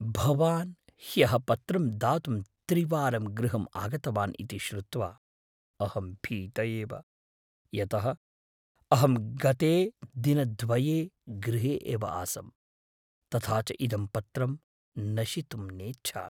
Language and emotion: Sanskrit, fearful